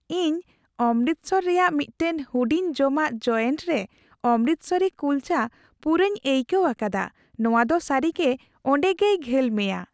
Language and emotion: Santali, happy